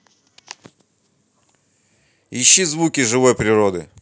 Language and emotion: Russian, neutral